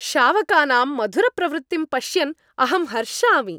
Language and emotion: Sanskrit, happy